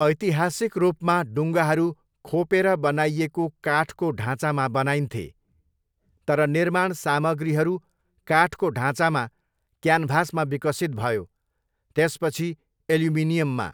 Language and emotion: Nepali, neutral